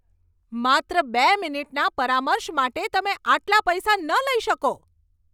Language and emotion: Gujarati, angry